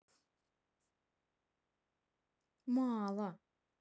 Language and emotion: Russian, sad